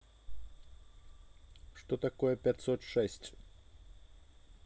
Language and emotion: Russian, neutral